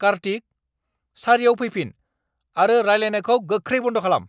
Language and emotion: Bodo, angry